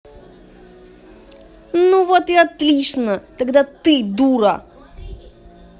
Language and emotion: Russian, angry